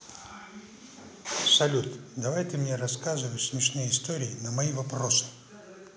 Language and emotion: Russian, neutral